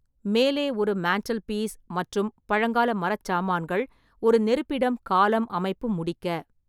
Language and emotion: Tamil, neutral